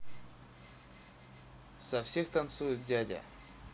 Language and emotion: Russian, neutral